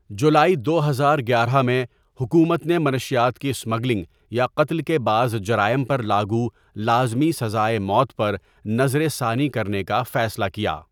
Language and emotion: Urdu, neutral